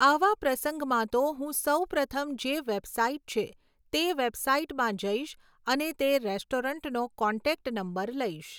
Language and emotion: Gujarati, neutral